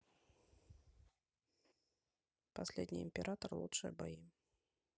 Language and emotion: Russian, neutral